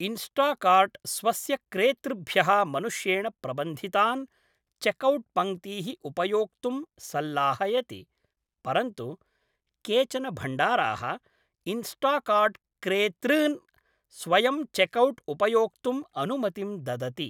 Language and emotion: Sanskrit, neutral